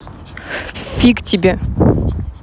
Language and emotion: Russian, angry